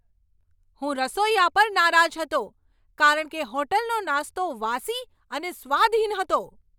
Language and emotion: Gujarati, angry